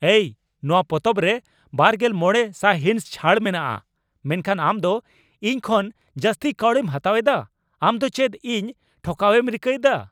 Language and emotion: Santali, angry